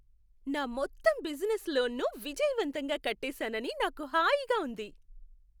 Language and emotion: Telugu, happy